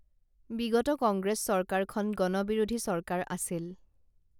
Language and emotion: Assamese, neutral